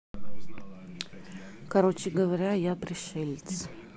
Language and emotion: Russian, neutral